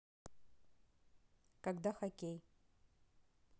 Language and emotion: Russian, neutral